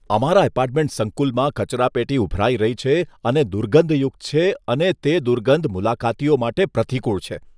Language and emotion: Gujarati, disgusted